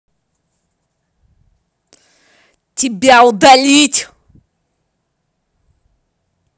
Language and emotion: Russian, angry